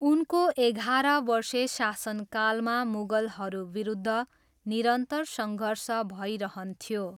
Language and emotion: Nepali, neutral